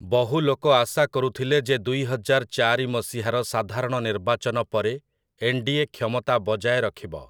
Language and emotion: Odia, neutral